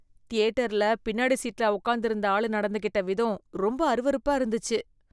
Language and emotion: Tamil, disgusted